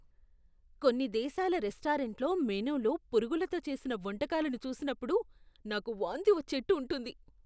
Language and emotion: Telugu, disgusted